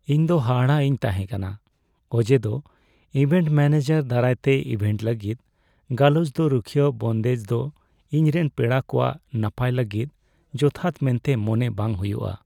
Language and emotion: Santali, sad